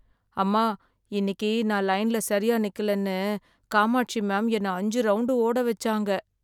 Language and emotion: Tamil, sad